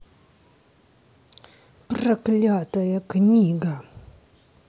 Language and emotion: Russian, angry